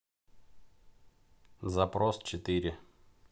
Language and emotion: Russian, neutral